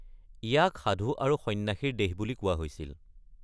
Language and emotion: Assamese, neutral